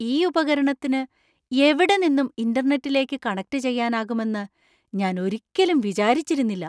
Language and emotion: Malayalam, surprised